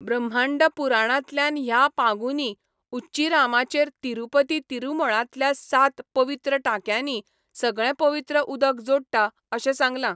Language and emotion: Goan Konkani, neutral